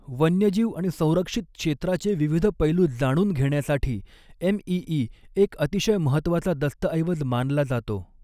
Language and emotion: Marathi, neutral